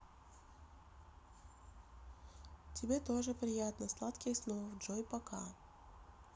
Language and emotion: Russian, neutral